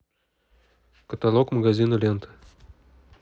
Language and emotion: Russian, neutral